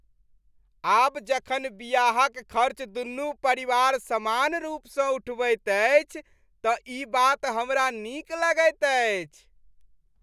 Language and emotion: Maithili, happy